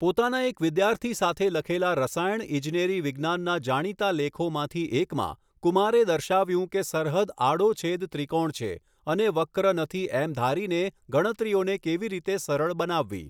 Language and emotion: Gujarati, neutral